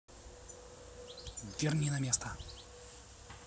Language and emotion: Russian, neutral